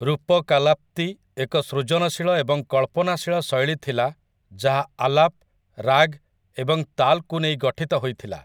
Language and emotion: Odia, neutral